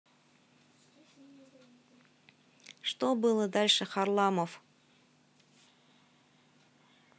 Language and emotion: Russian, neutral